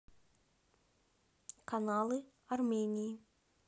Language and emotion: Russian, neutral